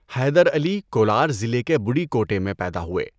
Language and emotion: Urdu, neutral